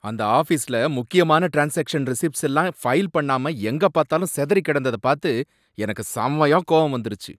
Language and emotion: Tamil, angry